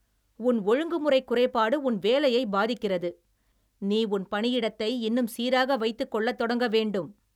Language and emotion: Tamil, angry